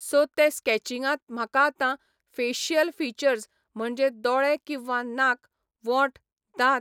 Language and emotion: Goan Konkani, neutral